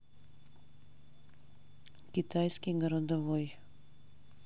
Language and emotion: Russian, neutral